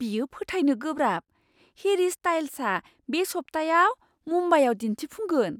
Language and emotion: Bodo, surprised